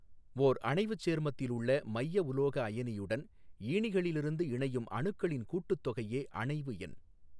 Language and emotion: Tamil, neutral